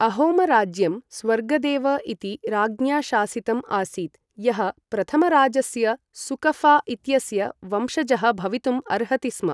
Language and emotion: Sanskrit, neutral